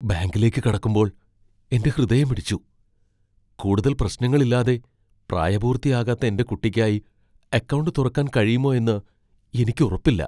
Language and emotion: Malayalam, fearful